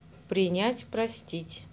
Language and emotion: Russian, neutral